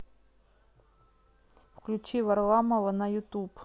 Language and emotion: Russian, neutral